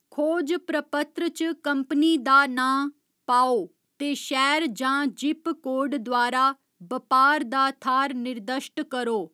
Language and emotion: Dogri, neutral